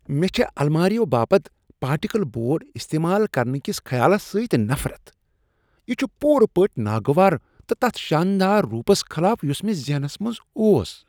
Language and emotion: Kashmiri, disgusted